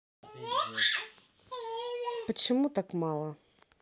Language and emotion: Russian, neutral